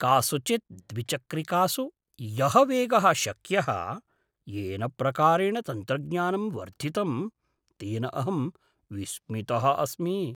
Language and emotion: Sanskrit, surprised